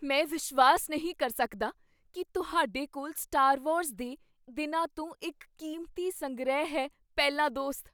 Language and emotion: Punjabi, surprised